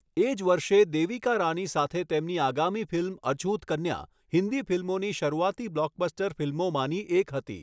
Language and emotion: Gujarati, neutral